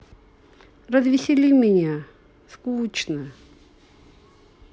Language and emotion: Russian, sad